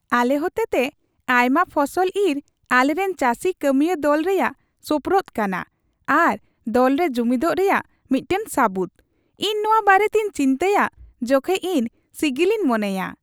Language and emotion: Santali, happy